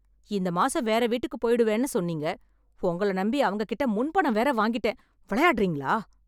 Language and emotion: Tamil, angry